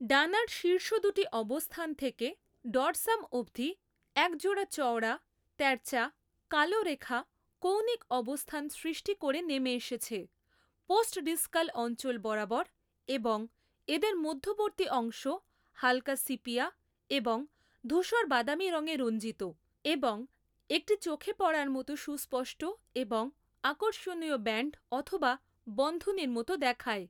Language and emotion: Bengali, neutral